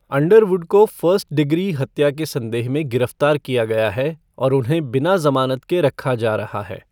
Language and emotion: Hindi, neutral